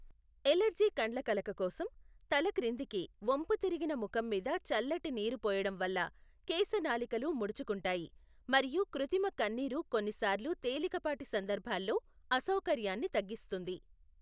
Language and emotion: Telugu, neutral